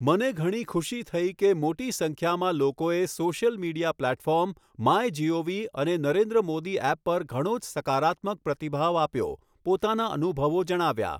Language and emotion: Gujarati, neutral